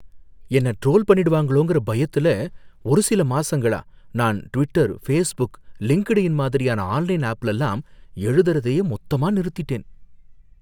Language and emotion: Tamil, fearful